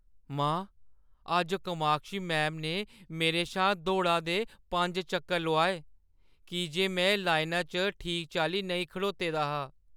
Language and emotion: Dogri, sad